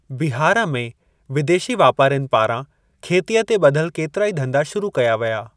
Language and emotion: Sindhi, neutral